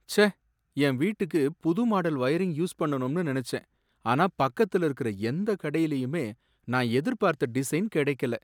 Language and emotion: Tamil, sad